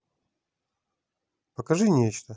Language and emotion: Russian, neutral